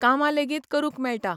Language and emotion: Goan Konkani, neutral